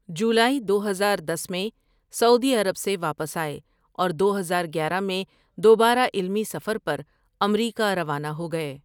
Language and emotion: Urdu, neutral